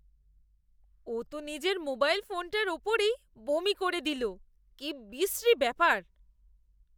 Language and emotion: Bengali, disgusted